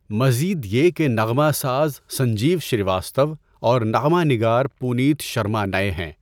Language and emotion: Urdu, neutral